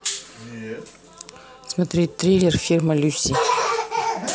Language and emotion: Russian, neutral